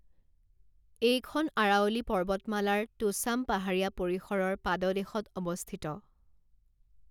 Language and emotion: Assamese, neutral